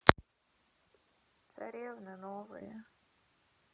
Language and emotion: Russian, sad